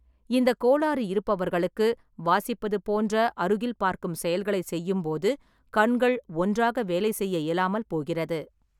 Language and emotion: Tamil, neutral